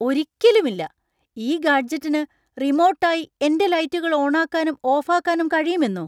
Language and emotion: Malayalam, surprised